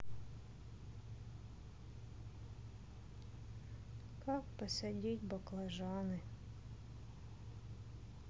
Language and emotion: Russian, sad